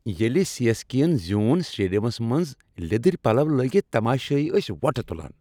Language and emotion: Kashmiri, happy